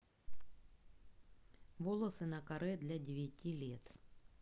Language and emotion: Russian, neutral